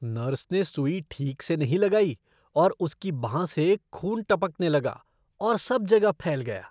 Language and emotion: Hindi, disgusted